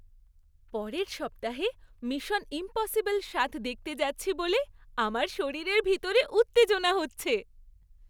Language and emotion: Bengali, happy